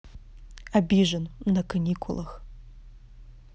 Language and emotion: Russian, angry